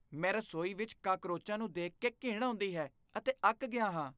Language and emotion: Punjabi, disgusted